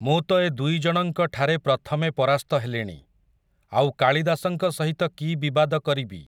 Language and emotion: Odia, neutral